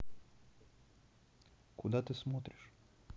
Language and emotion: Russian, neutral